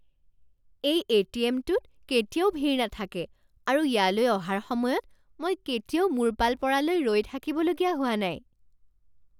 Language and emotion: Assamese, surprised